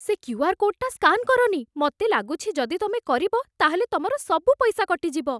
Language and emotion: Odia, fearful